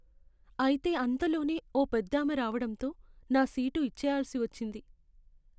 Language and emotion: Telugu, sad